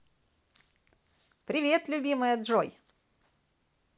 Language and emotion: Russian, positive